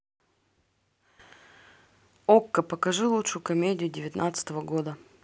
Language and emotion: Russian, neutral